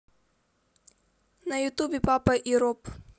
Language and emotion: Russian, neutral